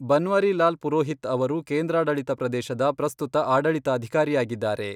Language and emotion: Kannada, neutral